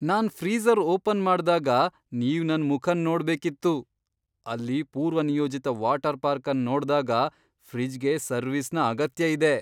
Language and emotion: Kannada, surprised